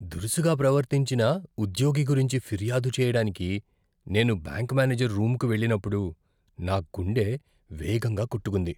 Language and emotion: Telugu, fearful